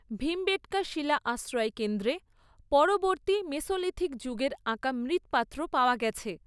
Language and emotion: Bengali, neutral